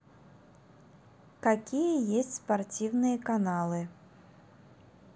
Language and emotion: Russian, neutral